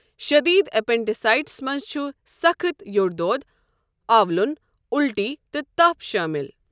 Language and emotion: Kashmiri, neutral